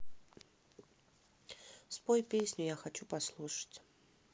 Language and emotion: Russian, neutral